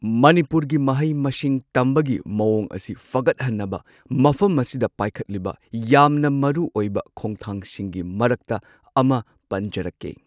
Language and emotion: Manipuri, neutral